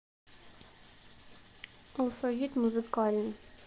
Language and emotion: Russian, neutral